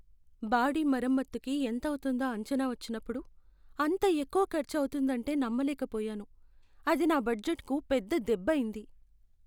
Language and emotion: Telugu, sad